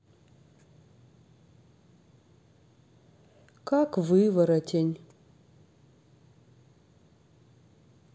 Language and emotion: Russian, sad